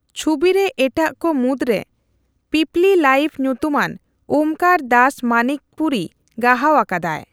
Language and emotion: Santali, neutral